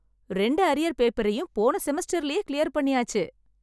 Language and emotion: Tamil, happy